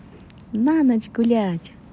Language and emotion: Russian, positive